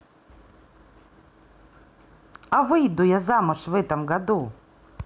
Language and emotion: Russian, positive